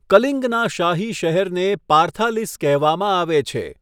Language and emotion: Gujarati, neutral